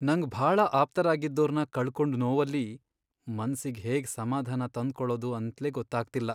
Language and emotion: Kannada, sad